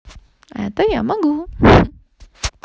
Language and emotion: Russian, positive